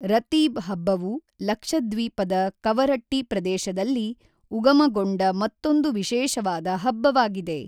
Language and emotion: Kannada, neutral